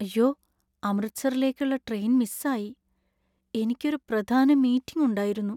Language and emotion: Malayalam, sad